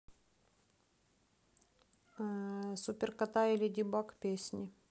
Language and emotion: Russian, neutral